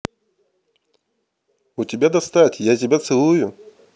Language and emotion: Russian, neutral